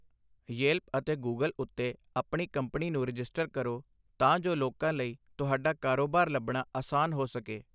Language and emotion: Punjabi, neutral